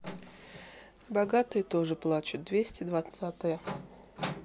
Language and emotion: Russian, neutral